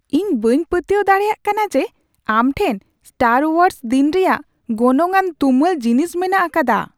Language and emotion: Santali, surprised